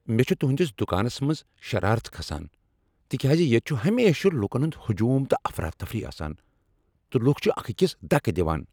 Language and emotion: Kashmiri, angry